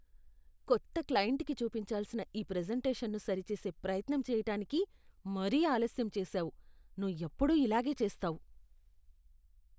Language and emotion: Telugu, disgusted